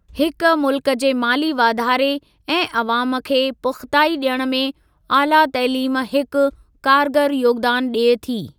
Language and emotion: Sindhi, neutral